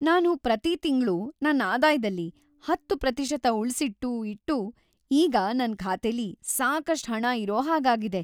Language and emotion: Kannada, happy